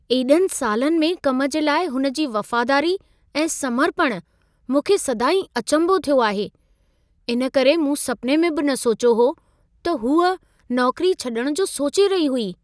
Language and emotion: Sindhi, surprised